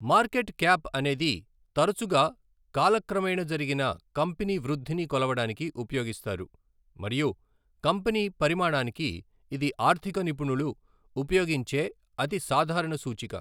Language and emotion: Telugu, neutral